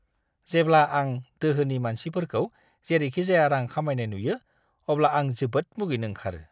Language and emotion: Bodo, disgusted